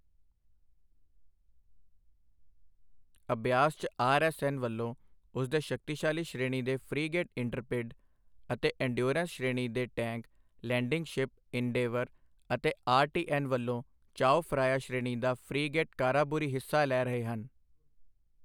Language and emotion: Punjabi, neutral